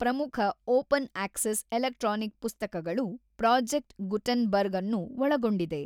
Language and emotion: Kannada, neutral